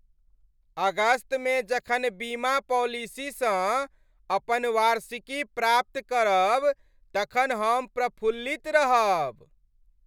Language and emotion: Maithili, happy